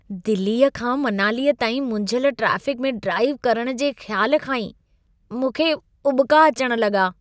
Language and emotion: Sindhi, disgusted